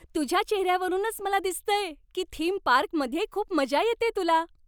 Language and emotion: Marathi, happy